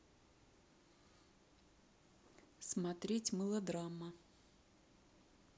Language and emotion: Russian, neutral